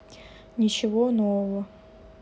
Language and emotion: Russian, neutral